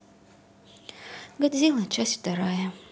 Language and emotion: Russian, sad